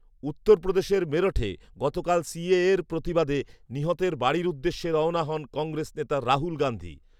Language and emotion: Bengali, neutral